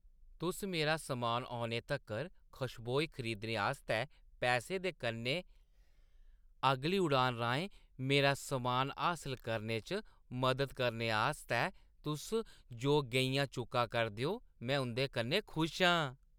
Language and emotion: Dogri, happy